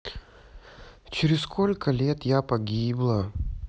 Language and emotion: Russian, sad